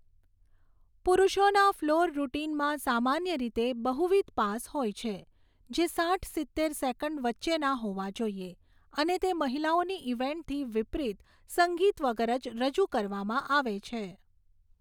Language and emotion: Gujarati, neutral